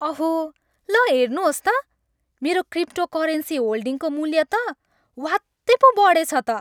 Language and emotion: Nepali, happy